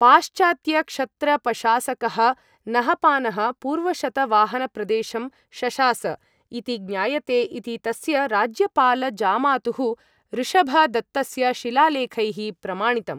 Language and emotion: Sanskrit, neutral